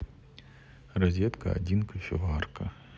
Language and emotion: Russian, neutral